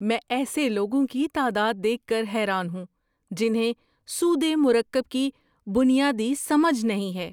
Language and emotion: Urdu, surprised